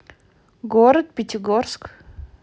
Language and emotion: Russian, neutral